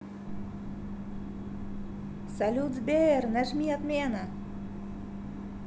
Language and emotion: Russian, positive